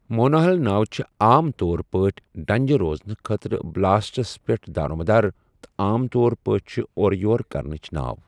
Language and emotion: Kashmiri, neutral